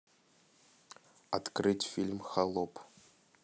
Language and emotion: Russian, neutral